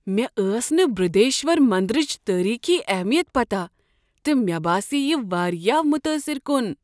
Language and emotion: Kashmiri, surprised